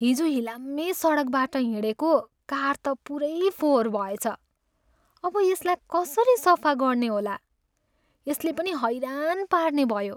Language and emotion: Nepali, sad